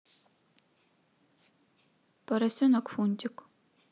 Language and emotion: Russian, neutral